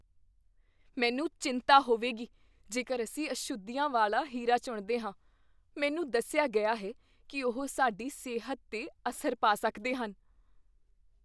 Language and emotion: Punjabi, fearful